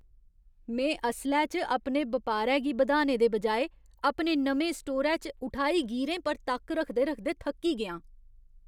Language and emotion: Dogri, disgusted